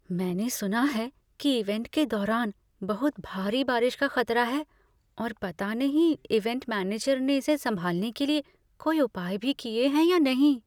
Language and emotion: Hindi, fearful